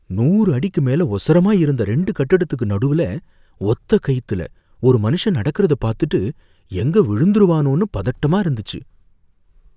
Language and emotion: Tamil, fearful